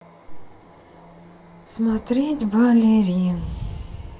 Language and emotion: Russian, sad